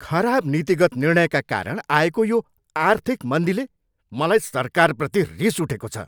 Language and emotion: Nepali, angry